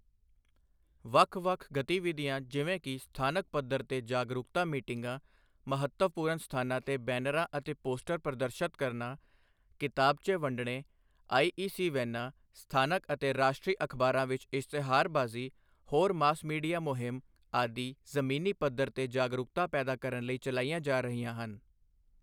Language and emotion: Punjabi, neutral